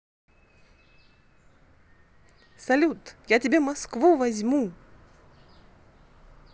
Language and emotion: Russian, positive